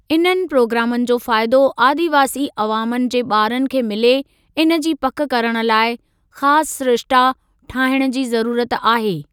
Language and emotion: Sindhi, neutral